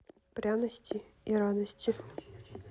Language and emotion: Russian, neutral